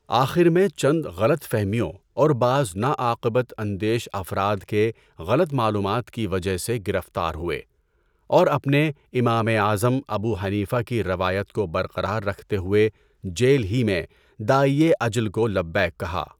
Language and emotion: Urdu, neutral